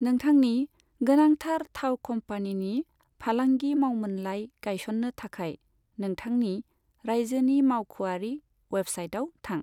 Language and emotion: Bodo, neutral